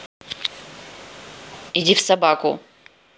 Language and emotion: Russian, angry